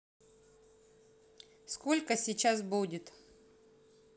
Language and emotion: Russian, neutral